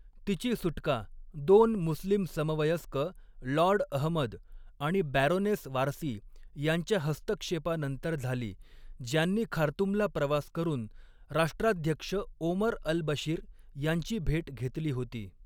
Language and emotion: Marathi, neutral